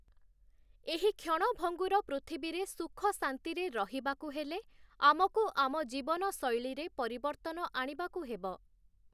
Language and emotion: Odia, neutral